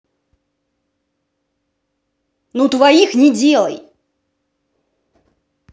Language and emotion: Russian, angry